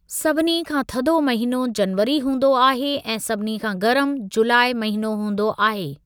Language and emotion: Sindhi, neutral